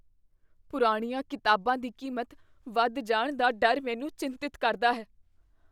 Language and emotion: Punjabi, fearful